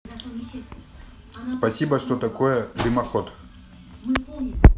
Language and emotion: Russian, neutral